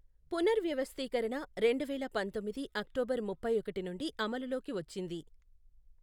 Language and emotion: Telugu, neutral